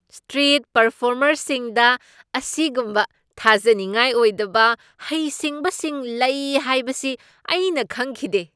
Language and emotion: Manipuri, surprised